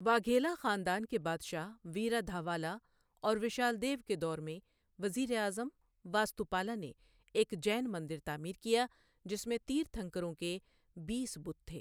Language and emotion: Urdu, neutral